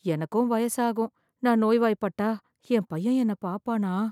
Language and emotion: Tamil, fearful